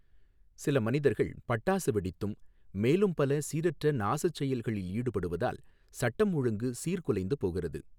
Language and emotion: Tamil, neutral